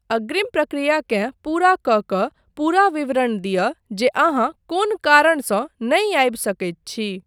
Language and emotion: Maithili, neutral